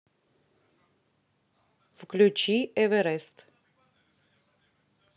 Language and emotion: Russian, neutral